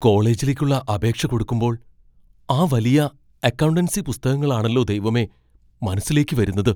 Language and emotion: Malayalam, fearful